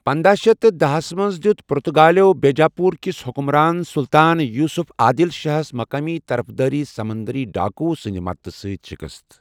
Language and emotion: Kashmiri, neutral